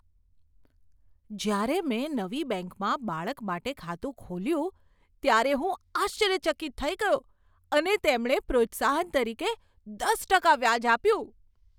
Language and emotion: Gujarati, surprised